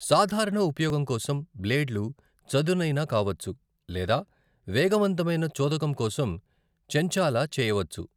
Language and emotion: Telugu, neutral